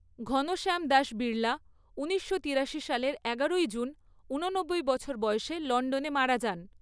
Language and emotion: Bengali, neutral